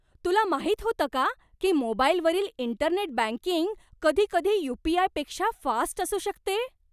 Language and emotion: Marathi, surprised